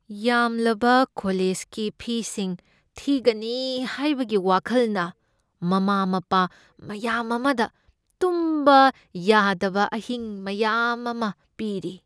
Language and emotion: Manipuri, fearful